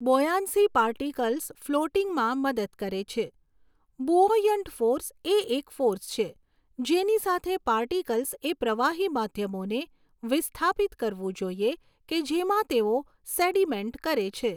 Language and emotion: Gujarati, neutral